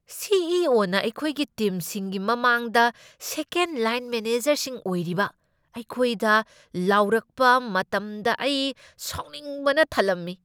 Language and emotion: Manipuri, angry